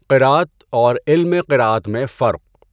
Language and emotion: Urdu, neutral